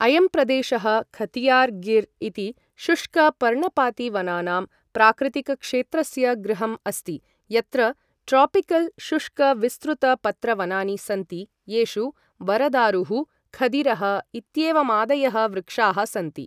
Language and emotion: Sanskrit, neutral